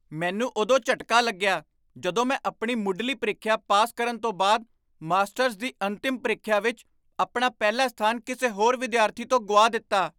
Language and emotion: Punjabi, surprised